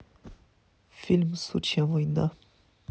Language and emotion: Russian, neutral